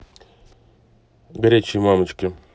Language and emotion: Russian, neutral